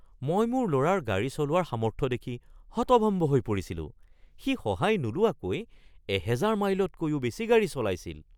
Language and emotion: Assamese, surprised